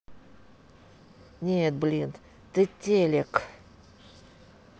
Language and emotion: Russian, neutral